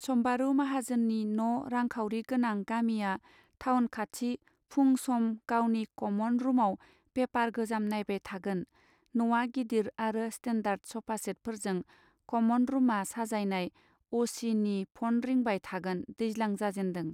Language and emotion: Bodo, neutral